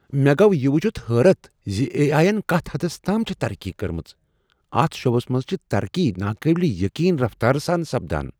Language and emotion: Kashmiri, surprised